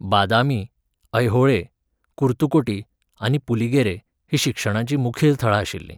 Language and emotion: Goan Konkani, neutral